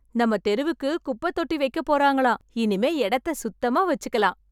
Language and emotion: Tamil, happy